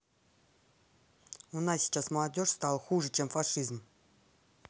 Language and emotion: Russian, angry